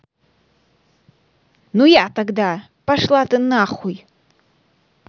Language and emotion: Russian, angry